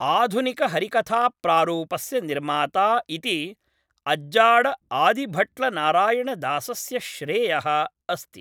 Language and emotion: Sanskrit, neutral